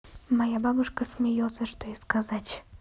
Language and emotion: Russian, neutral